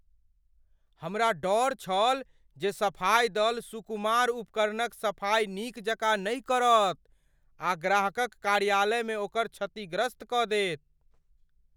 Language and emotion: Maithili, fearful